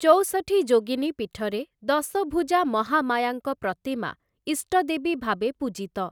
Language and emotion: Odia, neutral